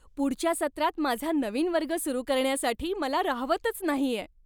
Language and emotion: Marathi, happy